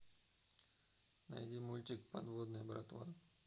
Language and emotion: Russian, neutral